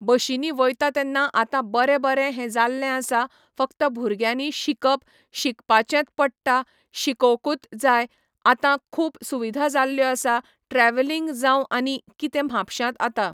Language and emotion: Goan Konkani, neutral